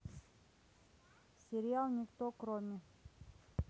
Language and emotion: Russian, neutral